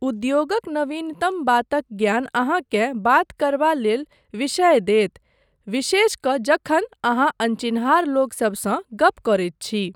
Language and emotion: Maithili, neutral